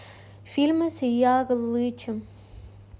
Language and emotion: Russian, neutral